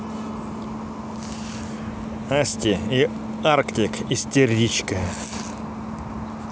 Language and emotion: Russian, neutral